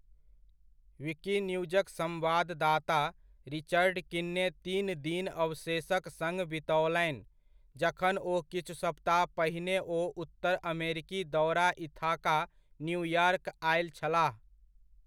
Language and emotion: Maithili, neutral